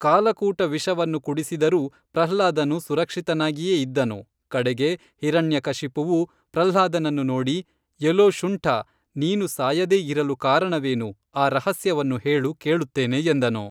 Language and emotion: Kannada, neutral